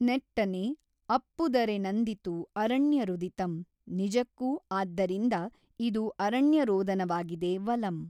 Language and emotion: Kannada, neutral